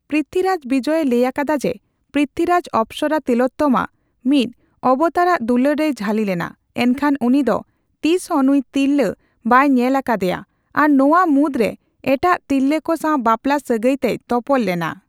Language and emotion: Santali, neutral